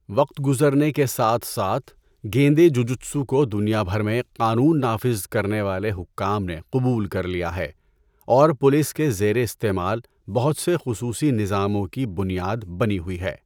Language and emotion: Urdu, neutral